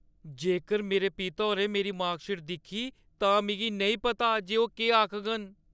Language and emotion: Dogri, fearful